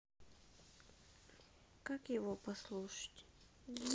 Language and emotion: Russian, sad